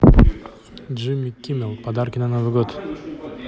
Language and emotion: Russian, neutral